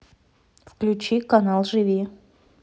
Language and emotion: Russian, neutral